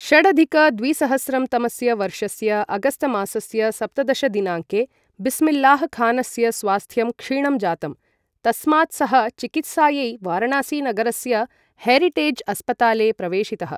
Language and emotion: Sanskrit, neutral